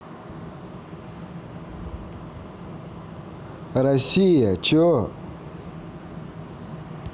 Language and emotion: Russian, neutral